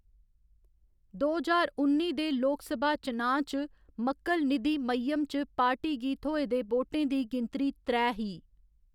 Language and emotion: Dogri, neutral